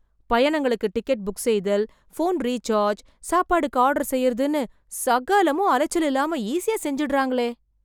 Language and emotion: Tamil, surprised